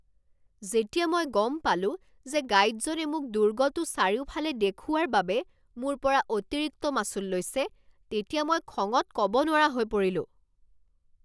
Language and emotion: Assamese, angry